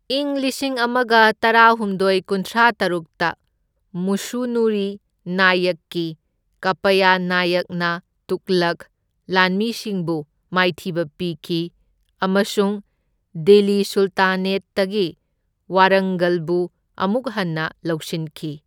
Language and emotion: Manipuri, neutral